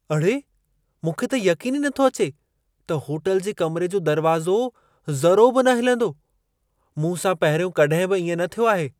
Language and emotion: Sindhi, surprised